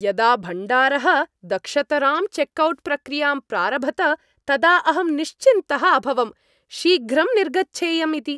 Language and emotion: Sanskrit, happy